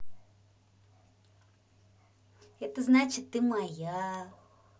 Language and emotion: Russian, positive